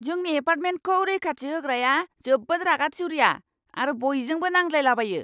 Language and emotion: Bodo, angry